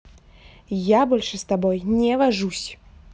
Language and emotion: Russian, angry